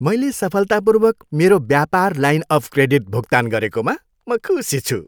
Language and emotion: Nepali, happy